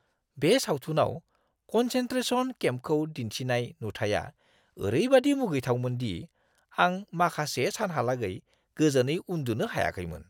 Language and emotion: Bodo, disgusted